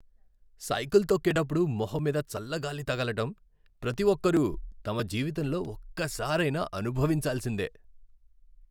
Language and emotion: Telugu, happy